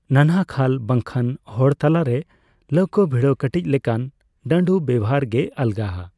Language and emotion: Santali, neutral